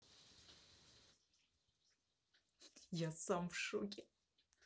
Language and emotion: Russian, positive